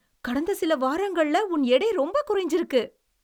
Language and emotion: Tamil, surprised